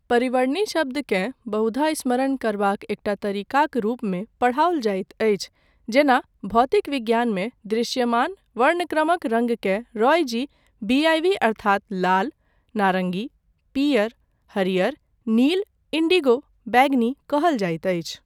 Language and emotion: Maithili, neutral